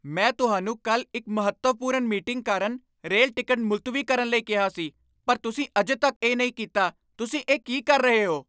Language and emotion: Punjabi, angry